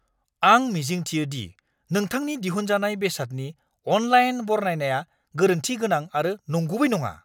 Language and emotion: Bodo, angry